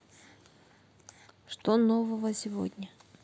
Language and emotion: Russian, neutral